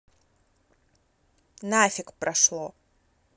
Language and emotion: Russian, angry